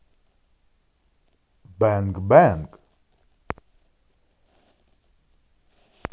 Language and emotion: Russian, positive